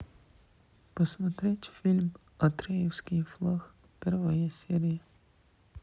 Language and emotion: Russian, sad